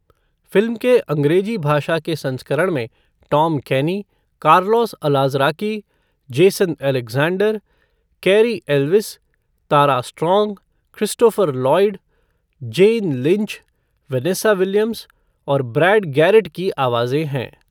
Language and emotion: Hindi, neutral